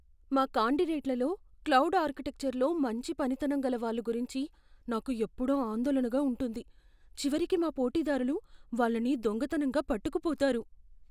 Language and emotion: Telugu, fearful